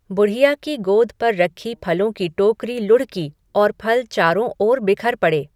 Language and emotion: Hindi, neutral